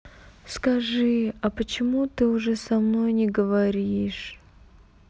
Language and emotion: Russian, sad